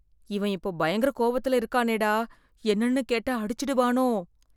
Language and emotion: Tamil, fearful